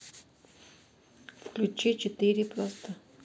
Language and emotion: Russian, neutral